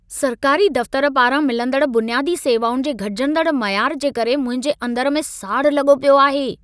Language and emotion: Sindhi, angry